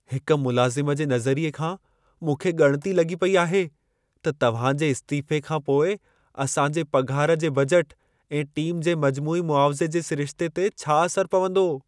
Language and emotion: Sindhi, fearful